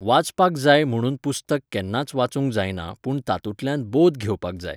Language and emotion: Goan Konkani, neutral